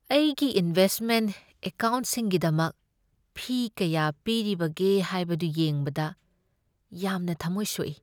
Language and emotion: Manipuri, sad